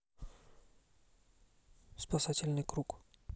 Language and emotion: Russian, neutral